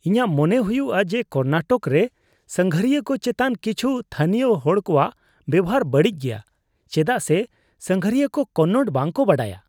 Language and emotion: Santali, disgusted